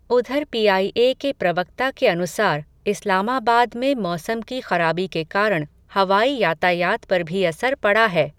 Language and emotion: Hindi, neutral